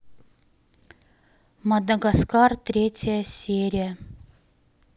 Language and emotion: Russian, neutral